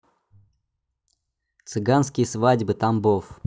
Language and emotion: Russian, neutral